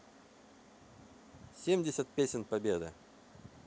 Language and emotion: Russian, neutral